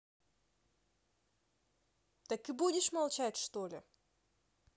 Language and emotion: Russian, neutral